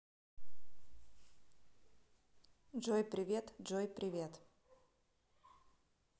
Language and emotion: Russian, neutral